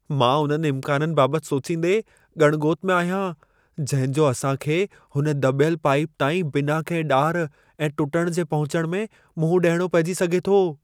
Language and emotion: Sindhi, fearful